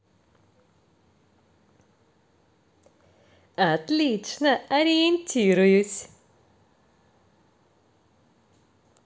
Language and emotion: Russian, positive